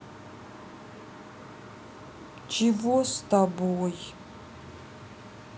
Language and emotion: Russian, neutral